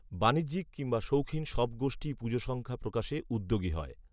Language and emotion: Bengali, neutral